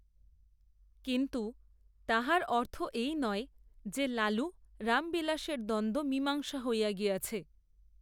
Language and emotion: Bengali, neutral